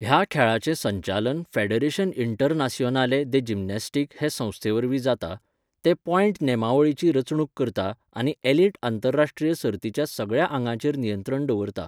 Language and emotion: Goan Konkani, neutral